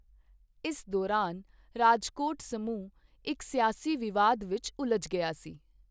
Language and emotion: Punjabi, neutral